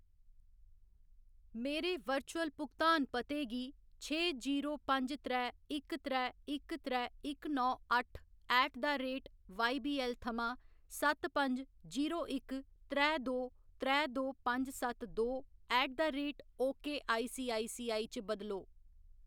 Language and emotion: Dogri, neutral